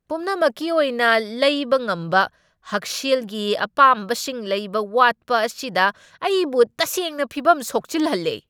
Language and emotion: Manipuri, angry